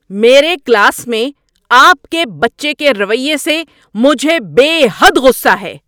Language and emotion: Urdu, angry